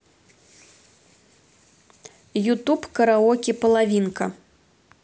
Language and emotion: Russian, neutral